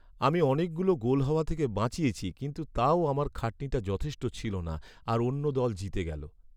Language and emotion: Bengali, sad